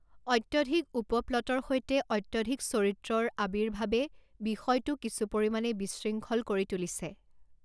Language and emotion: Assamese, neutral